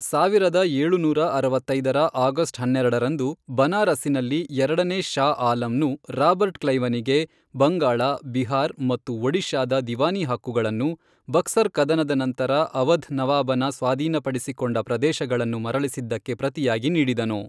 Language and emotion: Kannada, neutral